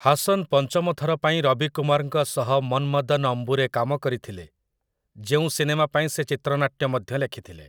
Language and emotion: Odia, neutral